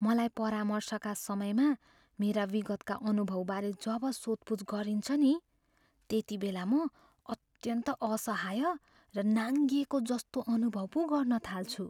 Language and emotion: Nepali, fearful